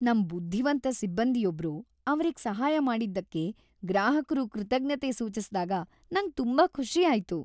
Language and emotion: Kannada, happy